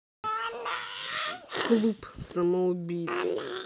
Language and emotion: Russian, neutral